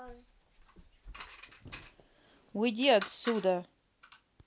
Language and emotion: Russian, angry